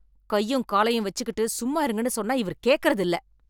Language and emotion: Tamil, angry